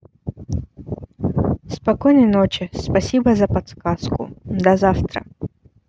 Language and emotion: Russian, neutral